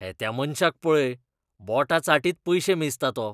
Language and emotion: Goan Konkani, disgusted